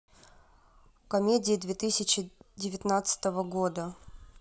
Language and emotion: Russian, neutral